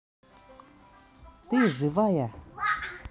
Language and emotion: Russian, angry